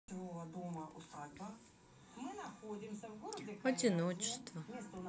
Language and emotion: Russian, sad